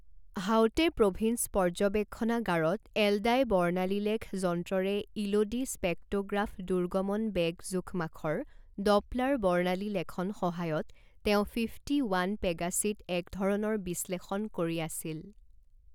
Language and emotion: Assamese, neutral